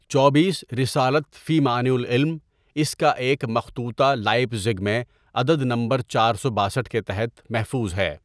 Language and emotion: Urdu, neutral